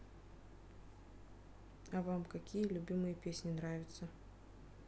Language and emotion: Russian, neutral